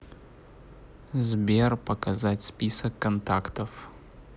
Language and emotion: Russian, neutral